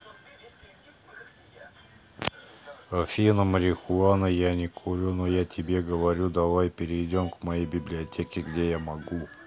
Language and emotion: Russian, neutral